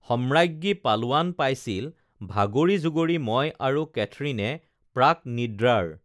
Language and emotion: Assamese, neutral